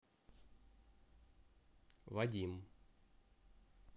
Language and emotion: Russian, neutral